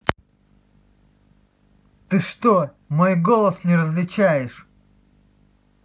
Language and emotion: Russian, angry